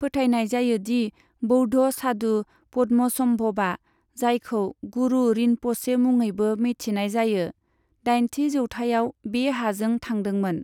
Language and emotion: Bodo, neutral